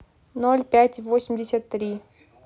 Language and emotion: Russian, neutral